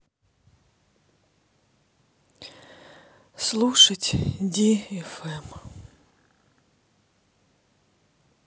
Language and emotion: Russian, sad